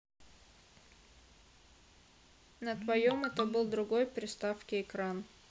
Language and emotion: Russian, neutral